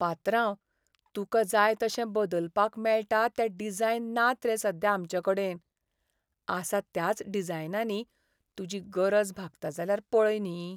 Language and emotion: Goan Konkani, sad